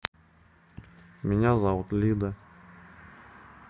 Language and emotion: Russian, neutral